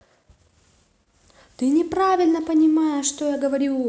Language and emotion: Russian, angry